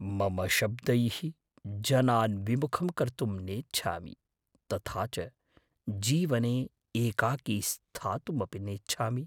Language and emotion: Sanskrit, fearful